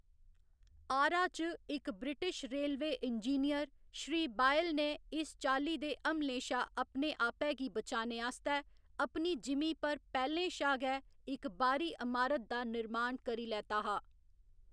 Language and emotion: Dogri, neutral